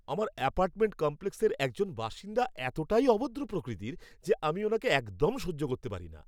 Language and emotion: Bengali, angry